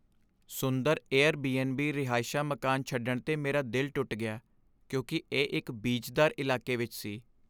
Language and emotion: Punjabi, sad